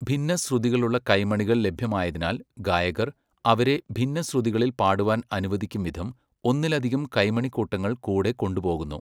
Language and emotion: Malayalam, neutral